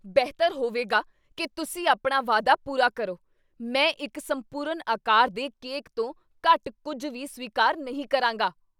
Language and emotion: Punjabi, angry